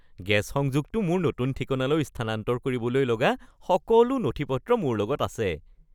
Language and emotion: Assamese, happy